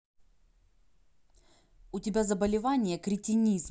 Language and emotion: Russian, angry